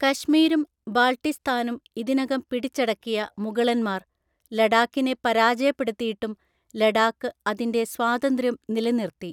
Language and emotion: Malayalam, neutral